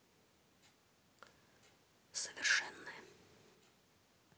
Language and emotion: Russian, neutral